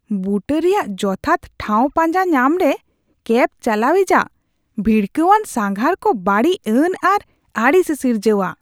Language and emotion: Santali, disgusted